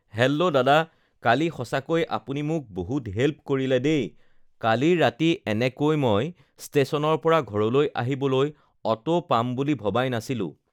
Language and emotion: Assamese, neutral